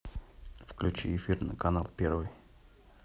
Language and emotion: Russian, neutral